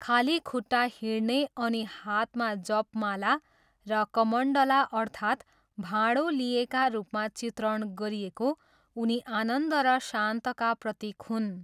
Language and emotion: Nepali, neutral